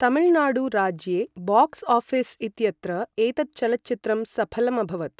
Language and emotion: Sanskrit, neutral